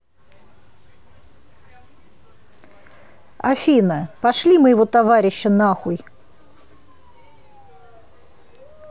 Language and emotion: Russian, neutral